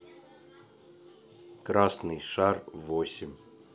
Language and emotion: Russian, neutral